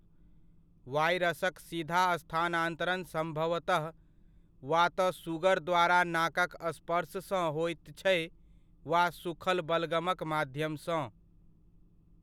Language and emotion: Maithili, neutral